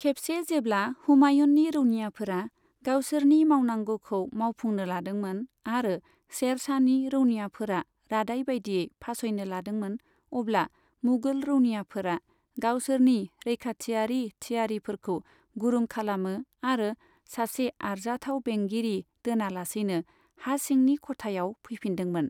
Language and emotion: Bodo, neutral